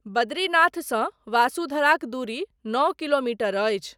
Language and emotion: Maithili, neutral